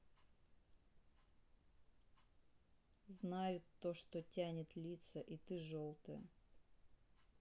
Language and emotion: Russian, sad